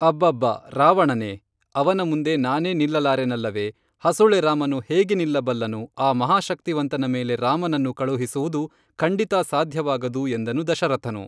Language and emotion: Kannada, neutral